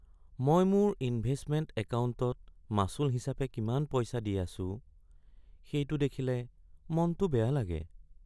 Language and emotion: Assamese, sad